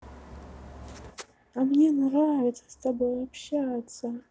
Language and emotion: Russian, positive